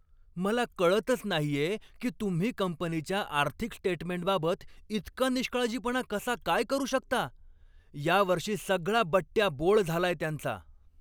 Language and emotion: Marathi, angry